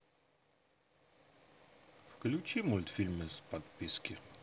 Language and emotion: Russian, neutral